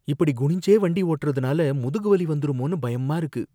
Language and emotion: Tamil, fearful